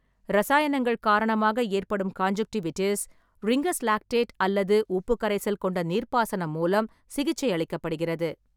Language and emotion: Tamil, neutral